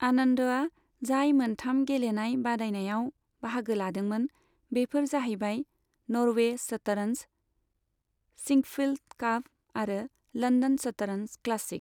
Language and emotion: Bodo, neutral